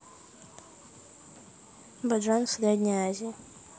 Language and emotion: Russian, neutral